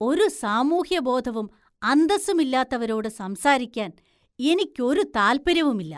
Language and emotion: Malayalam, disgusted